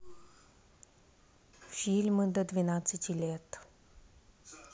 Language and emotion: Russian, neutral